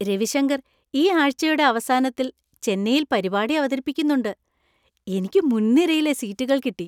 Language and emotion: Malayalam, happy